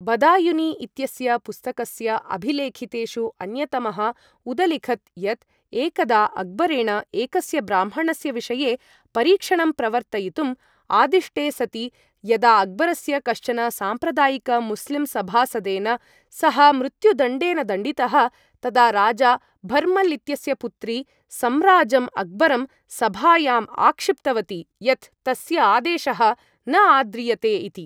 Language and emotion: Sanskrit, neutral